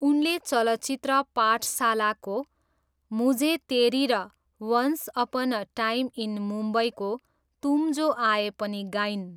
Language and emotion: Nepali, neutral